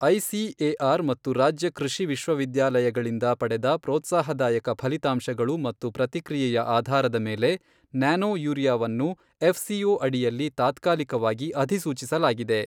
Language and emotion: Kannada, neutral